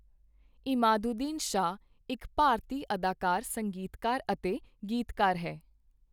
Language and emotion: Punjabi, neutral